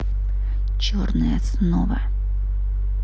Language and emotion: Russian, angry